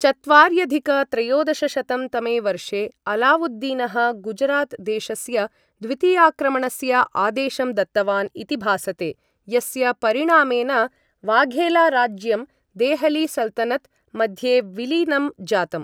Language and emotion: Sanskrit, neutral